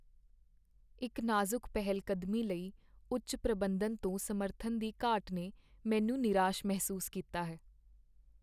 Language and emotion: Punjabi, sad